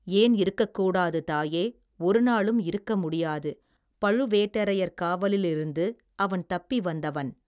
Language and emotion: Tamil, neutral